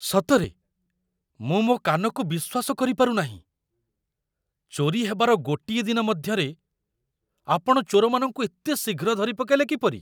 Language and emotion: Odia, surprised